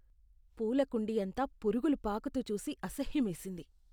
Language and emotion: Telugu, disgusted